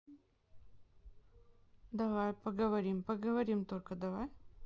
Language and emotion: Russian, neutral